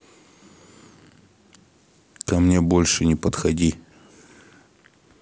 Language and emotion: Russian, angry